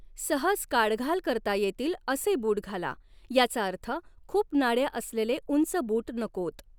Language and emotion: Marathi, neutral